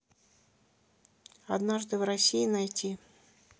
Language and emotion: Russian, neutral